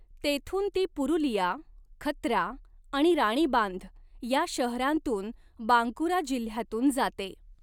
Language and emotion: Marathi, neutral